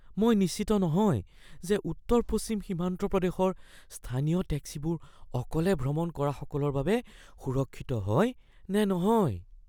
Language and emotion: Assamese, fearful